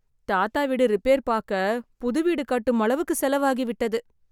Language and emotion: Tamil, sad